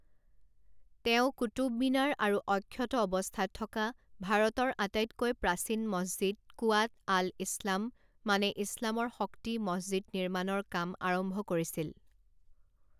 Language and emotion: Assamese, neutral